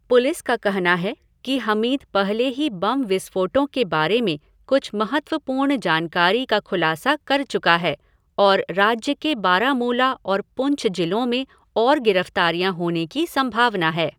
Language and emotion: Hindi, neutral